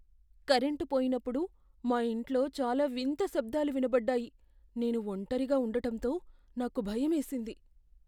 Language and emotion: Telugu, fearful